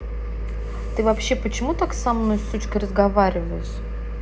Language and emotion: Russian, angry